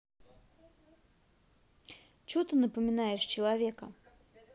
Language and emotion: Russian, angry